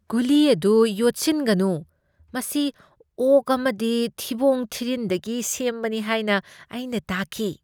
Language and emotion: Manipuri, disgusted